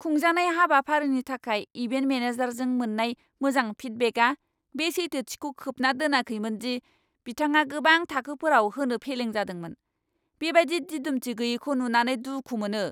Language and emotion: Bodo, angry